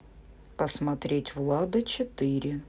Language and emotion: Russian, neutral